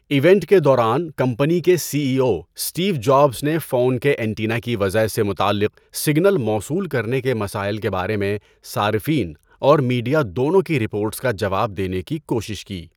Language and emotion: Urdu, neutral